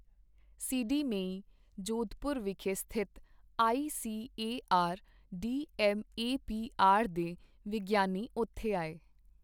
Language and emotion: Punjabi, neutral